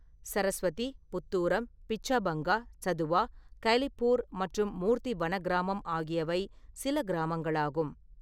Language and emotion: Tamil, neutral